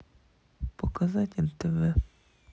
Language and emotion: Russian, neutral